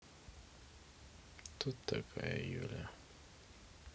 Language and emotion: Russian, neutral